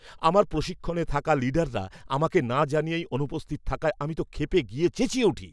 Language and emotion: Bengali, angry